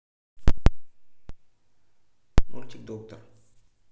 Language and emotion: Russian, neutral